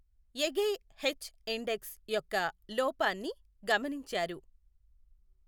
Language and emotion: Telugu, neutral